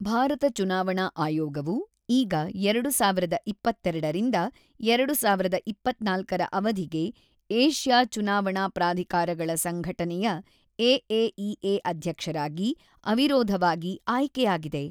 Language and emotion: Kannada, neutral